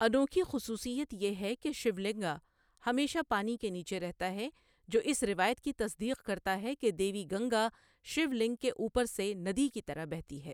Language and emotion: Urdu, neutral